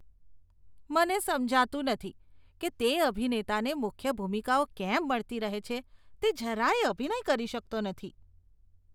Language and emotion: Gujarati, disgusted